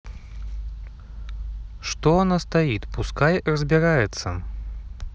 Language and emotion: Russian, neutral